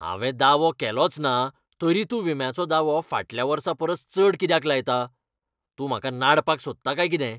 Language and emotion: Goan Konkani, angry